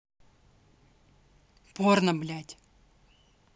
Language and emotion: Russian, angry